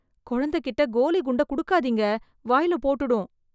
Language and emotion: Tamil, fearful